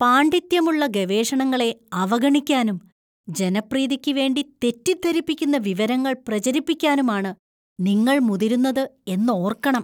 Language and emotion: Malayalam, disgusted